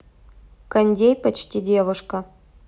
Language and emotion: Russian, neutral